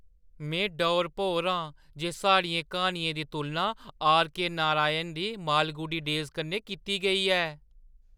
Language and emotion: Dogri, surprised